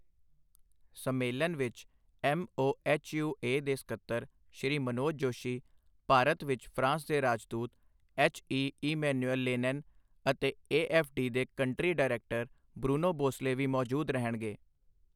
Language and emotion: Punjabi, neutral